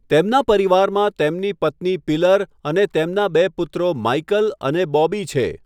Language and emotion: Gujarati, neutral